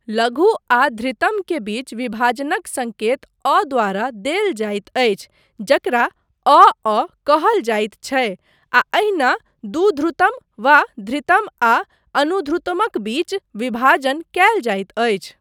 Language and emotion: Maithili, neutral